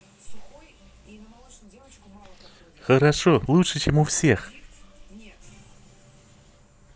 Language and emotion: Russian, positive